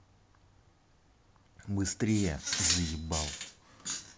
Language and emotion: Russian, angry